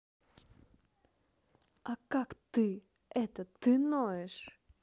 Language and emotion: Russian, angry